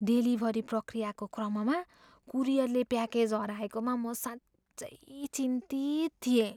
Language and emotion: Nepali, fearful